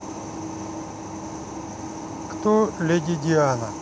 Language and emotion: Russian, neutral